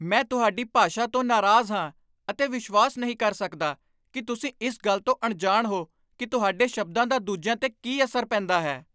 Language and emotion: Punjabi, angry